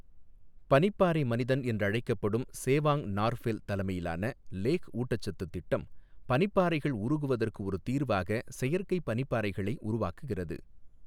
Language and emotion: Tamil, neutral